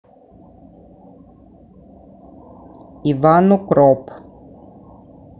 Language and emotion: Russian, neutral